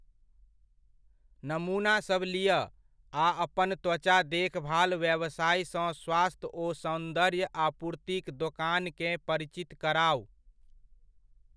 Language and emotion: Maithili, neutral